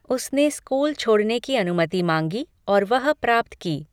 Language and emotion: Hindi, neutral